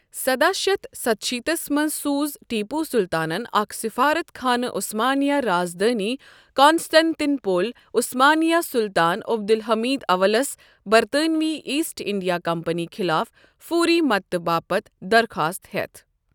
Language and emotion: Kashmiri, neutral